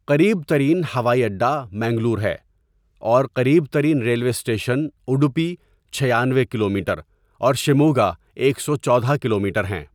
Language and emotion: Urdu, neutral